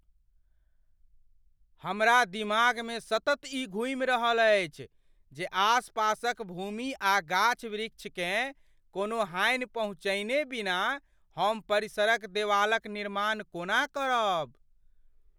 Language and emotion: Maithili, fearful